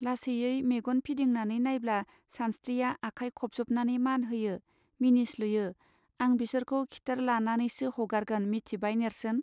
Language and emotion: Bodo, neutral